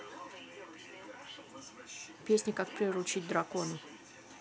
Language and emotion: Russian, neutral